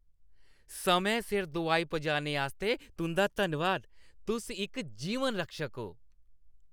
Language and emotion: Dogri, happy